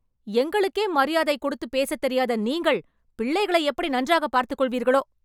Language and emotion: Tamil, angry